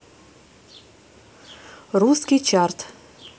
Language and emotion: Russian, neutral